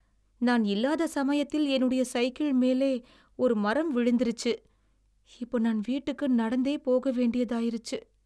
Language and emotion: Tamil, sad